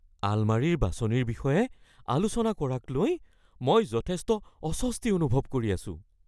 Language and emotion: Assamese, fearful